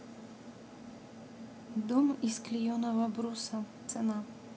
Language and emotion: Russian, neutral